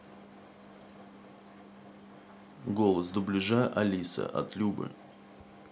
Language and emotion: Russian, neutral